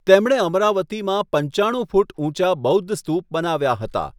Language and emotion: Gujarati, neutral